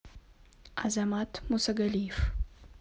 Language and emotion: Russian, neutral